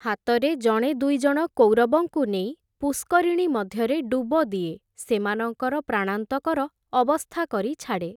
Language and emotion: Odia, neutral